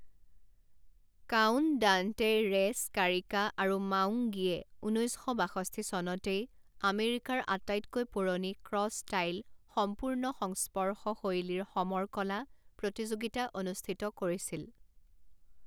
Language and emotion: Assamese, neutral